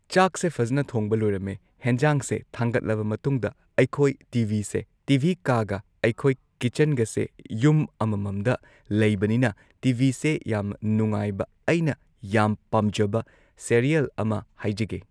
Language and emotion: Manipuri, neutral